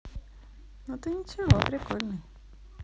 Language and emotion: Russian, positive